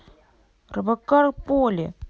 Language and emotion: Russian, neutral